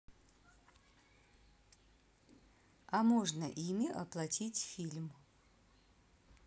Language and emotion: Russian, neutral